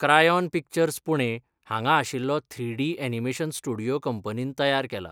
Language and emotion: Goan Konkani, neutral